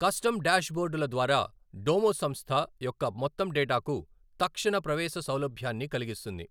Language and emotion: Telugu, neutral